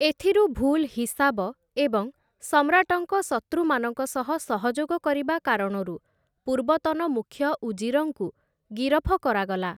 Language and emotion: Odia, neutral